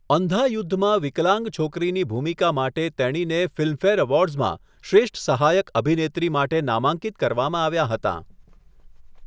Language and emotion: Gujarati, neutral